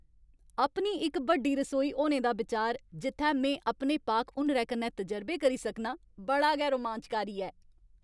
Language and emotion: Dogri, happy